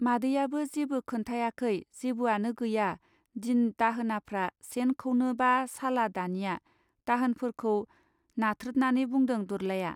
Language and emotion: Bodo, neutral